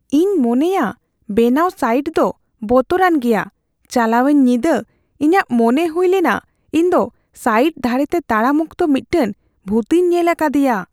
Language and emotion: Santali, fearful